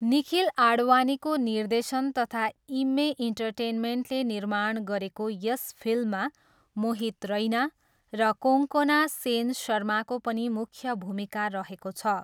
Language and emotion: Nepali, neutral